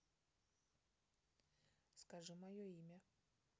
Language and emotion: Russian, neutral